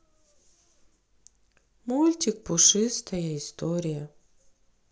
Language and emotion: Russian, sad